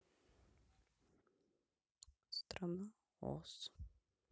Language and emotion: Russian, sad